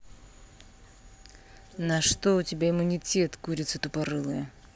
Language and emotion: Russian, angry